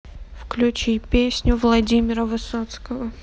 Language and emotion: Russian, neutral